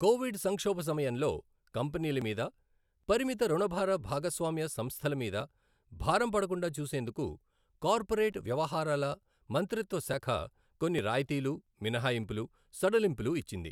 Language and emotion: Telugu, neutral